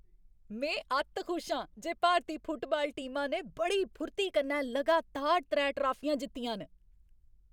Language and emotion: Dogri, happy